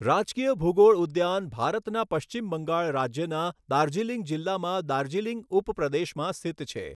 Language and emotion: Gujarati, neutral